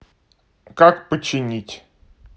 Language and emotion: Russian, neutral